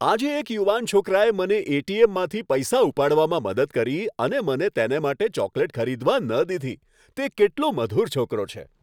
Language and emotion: Gujarati, happy